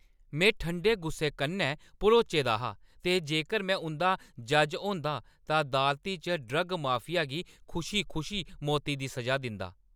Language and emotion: Dogri, angry